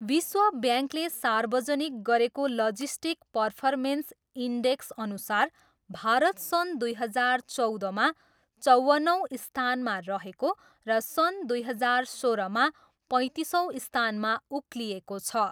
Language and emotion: Nepali, neutral